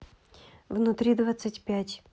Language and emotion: Russian, neutral